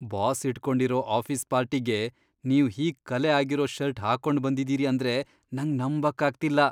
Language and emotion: Kannada, disgusted